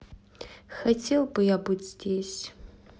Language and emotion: Russian, sad